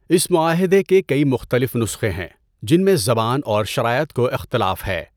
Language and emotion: Urdu, neutral